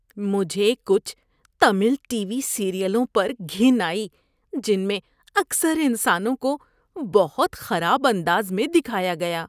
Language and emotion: Urdu, disgusted